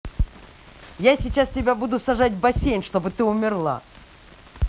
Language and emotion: Russian, angry